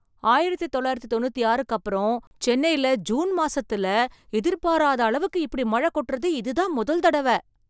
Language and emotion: Tamil, surprised